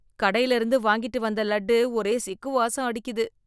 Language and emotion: Tamil, disgusted